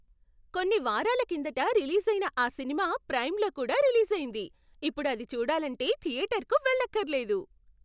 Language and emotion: Telugu, surprised